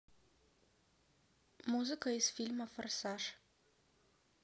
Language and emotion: Russian, neutral